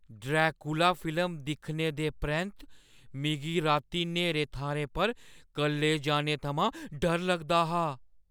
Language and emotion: Dogri, fearful